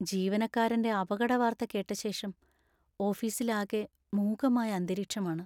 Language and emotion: Malayalam, sad